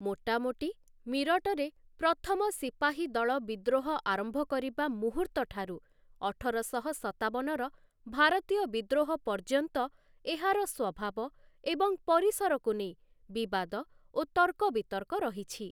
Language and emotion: Odia, neutral